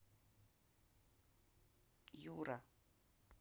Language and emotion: Russian, neutral